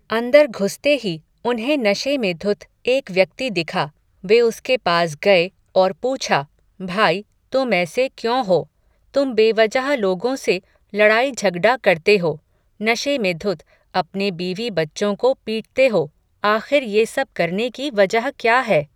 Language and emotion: Hindi, neutral